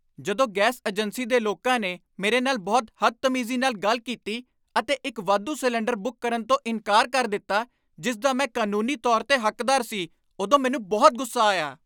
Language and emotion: Punjabi, angry